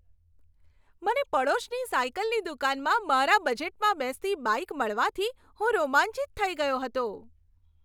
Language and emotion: Gujarati, happy